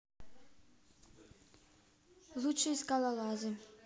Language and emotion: Russian, neutral